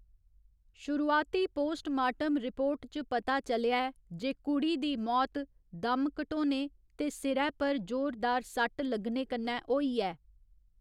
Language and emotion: Dogri, neutral